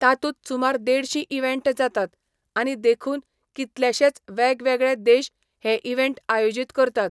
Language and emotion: Goan Konkani, neutral